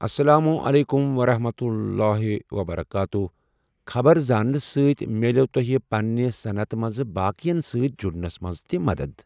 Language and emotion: Kashmiri, neutral